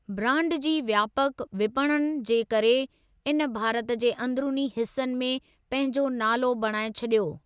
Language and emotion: Sindhi, neutral